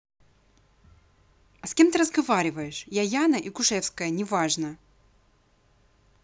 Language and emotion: Russian, angry